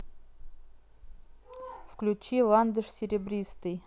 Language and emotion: Russian, neutral